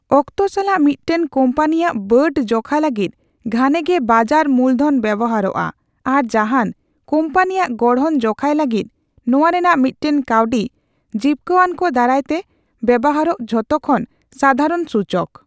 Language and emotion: Santali, neutral